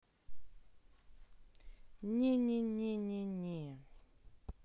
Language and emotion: Russian, neutral